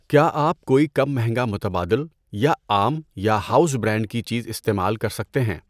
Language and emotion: Urdu, neutral